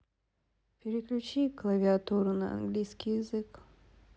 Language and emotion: Russian, sad